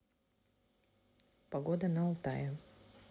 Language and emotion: Russian, neutral